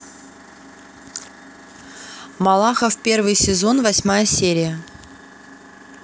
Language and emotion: Russian, neutral